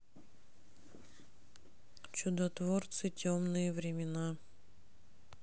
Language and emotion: Russian, neutral